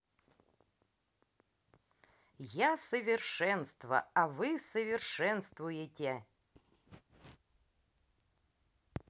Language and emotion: Russian, positive